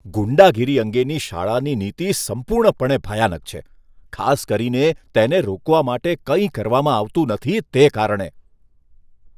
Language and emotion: Gujarati, disgusted